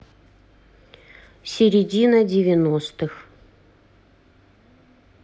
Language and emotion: Russian, neutral